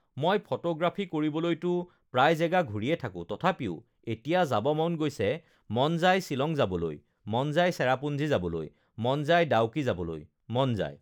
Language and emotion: Assamese, neutral